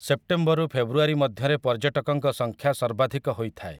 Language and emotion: Odia, neutral